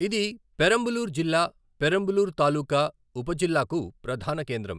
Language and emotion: Telugu, neutral